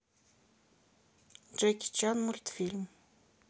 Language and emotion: Russian, neutral